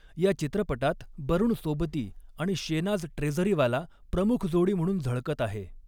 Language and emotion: Marathi, neutral